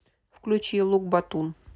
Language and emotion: Russian, neutral